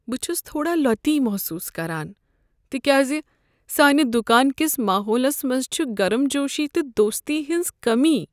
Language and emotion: Kashmiri, sad